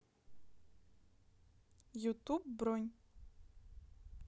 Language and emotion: Russian, neutral